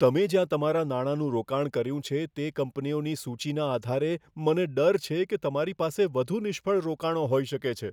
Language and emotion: Gujarati, fearful